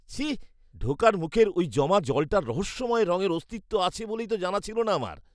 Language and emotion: Bengali, disgusted